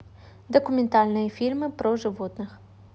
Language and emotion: Russian, neutral